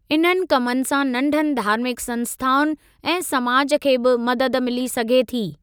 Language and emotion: Sindhi, neutral